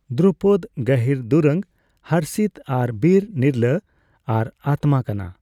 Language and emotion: Santali, neutral